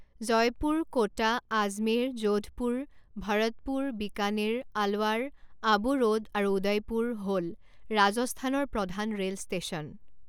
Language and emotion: Assamese, neutral